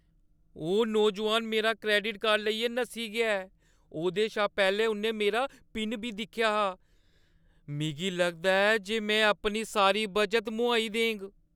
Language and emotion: Dogri, fearful